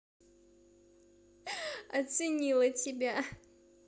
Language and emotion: Russian, positive